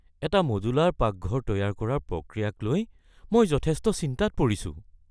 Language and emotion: Assamese, fearful